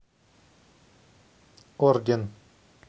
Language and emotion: Russian, neutral